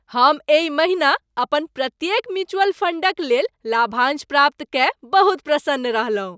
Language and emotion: Maithili, happy